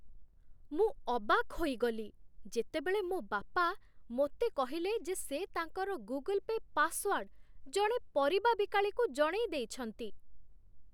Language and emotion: Odia, surprised